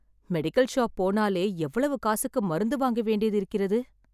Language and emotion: Tamil, sad